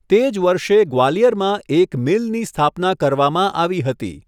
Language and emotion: Gujarati, neutral